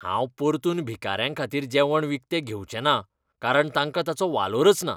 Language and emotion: Goan Konkani, disgusted